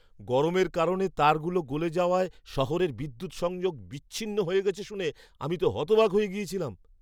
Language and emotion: Bengali, surprised